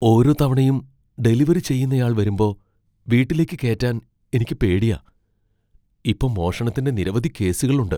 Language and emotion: Malayalam, fearful